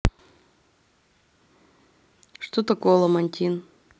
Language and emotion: Russian, neutral